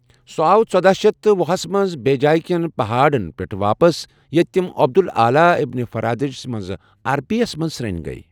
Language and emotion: Kashmiri, neutral